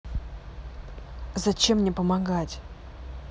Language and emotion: Russian, neutral